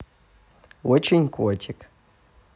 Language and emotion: Russian, positive